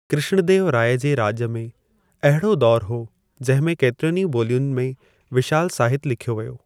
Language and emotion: Sindhi, neutral